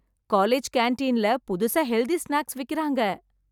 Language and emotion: Tamil, happy